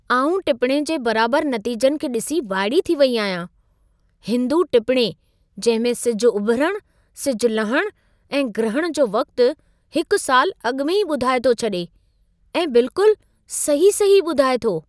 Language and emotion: Sindhi, surprised